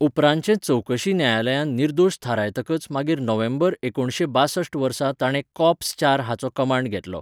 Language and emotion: Goan Konkani, neutral